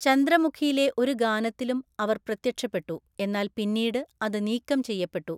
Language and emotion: Malayalam, neutral